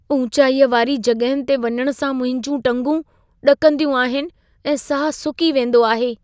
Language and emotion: Sindhi, fearful